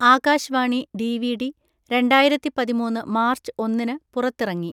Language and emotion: Malayalam, neutral